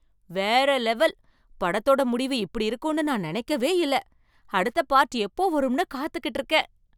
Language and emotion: Tamil, surprised